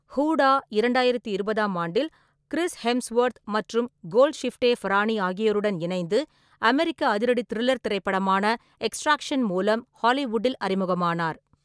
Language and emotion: Tamil, neutral